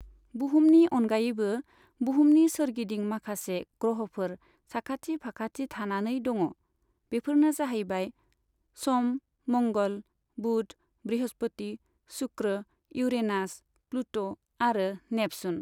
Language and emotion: Bodo, neutral